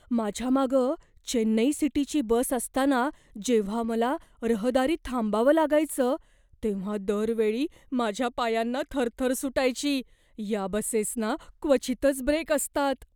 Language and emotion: Marathi, fearful